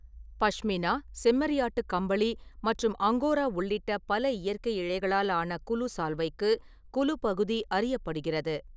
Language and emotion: Tamil, neutral